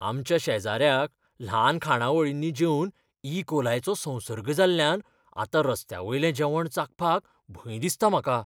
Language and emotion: Goan Konkani, fearful